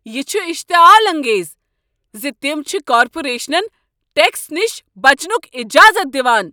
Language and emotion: Kashmiri, angry